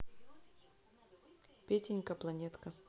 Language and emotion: Russian, neutral